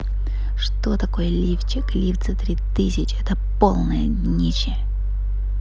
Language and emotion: Russian, positive